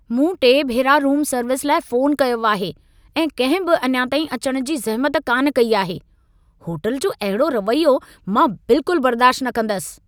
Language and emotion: Sindhi, angry